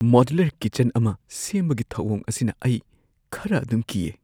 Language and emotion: Manipuri, fearful